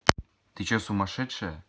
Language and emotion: Russian, angry